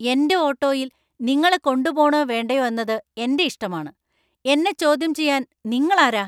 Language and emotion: Malayalam, angry